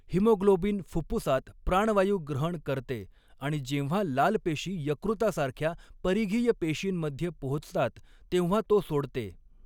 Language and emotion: Marathi, neutral